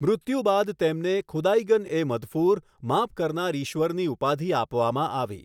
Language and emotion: Gujarati, neutral